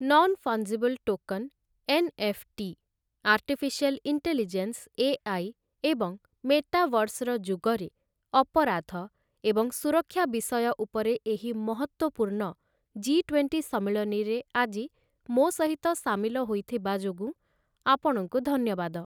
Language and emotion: Odia, neutral